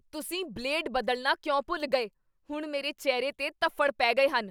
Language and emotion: Punjabi, angry